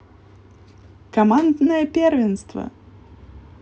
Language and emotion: Russian, positive